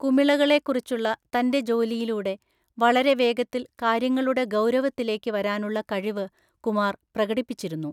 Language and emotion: Malayalam, neutral